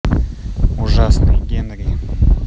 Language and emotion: Russian, neutral